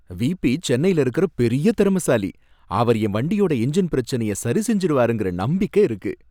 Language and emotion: Tamil, happy